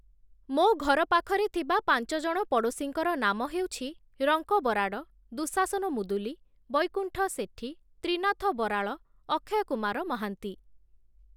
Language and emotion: Odia, neutral